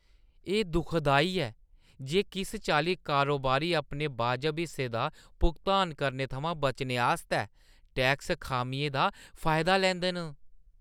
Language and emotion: Dogri, disgusted